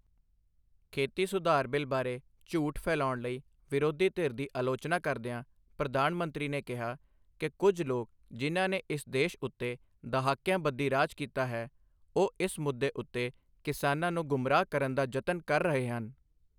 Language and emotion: Punjabi, neutral